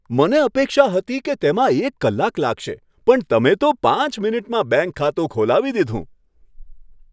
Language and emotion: Gujarati, happy